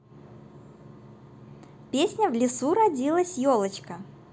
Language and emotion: Russian, positive